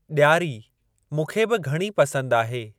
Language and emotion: Sindhi, neutral